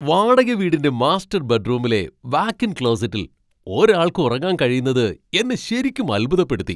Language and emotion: Malayalam, surprised